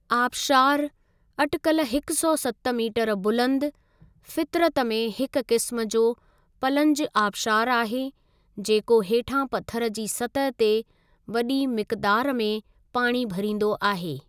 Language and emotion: Sindhi, neutral